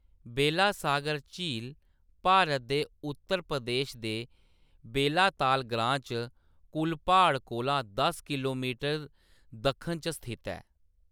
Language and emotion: Dogri, neutral